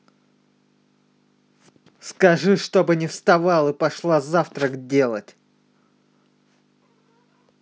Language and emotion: Russian, angry